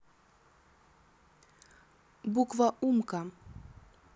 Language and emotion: Russian, neutral